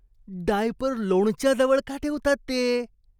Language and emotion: Marathi, disgusted